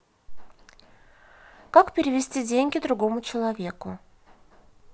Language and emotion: Russian, neutral